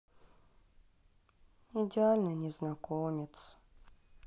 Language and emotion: Russian, sad